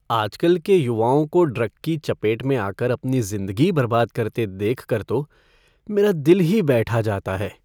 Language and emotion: Hindi, sad